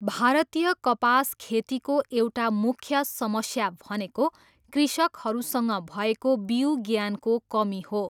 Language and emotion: Nepali, neutral